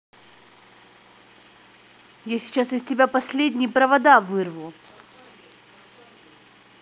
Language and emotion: Russian, angry